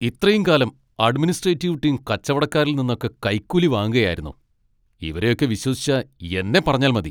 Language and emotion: Malayalam, angry